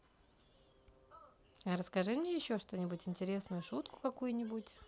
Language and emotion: Russian, positive